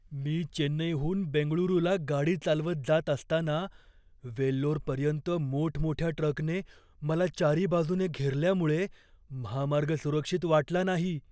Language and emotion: Marathi, fearful